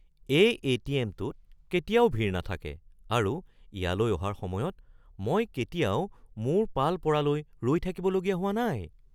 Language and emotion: Assamese, surprised